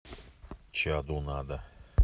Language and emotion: Russian, neutral